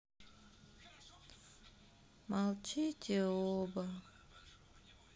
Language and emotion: Russian, sad